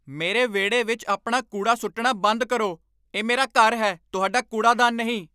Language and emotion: Punjabi, angry